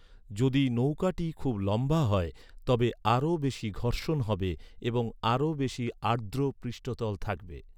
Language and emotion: Bengali, neutral